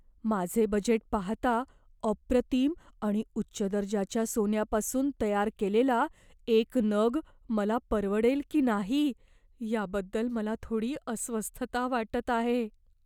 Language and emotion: Marathi, fearful